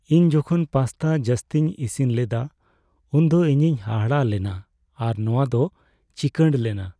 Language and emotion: Santali, sad